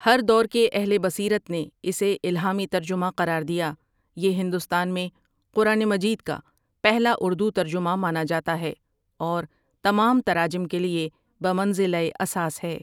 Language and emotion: Urdu, neutral